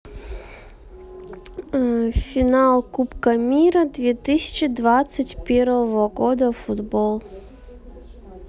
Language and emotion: Russian, neutral